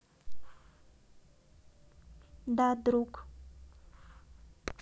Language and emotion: Russian, neutral